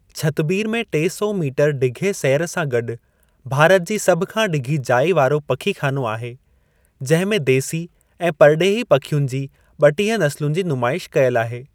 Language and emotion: Sindhi, neutral